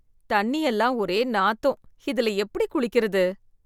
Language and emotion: Tamil, disgusted